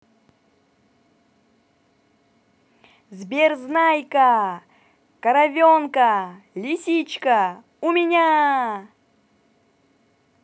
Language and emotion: Russian, positive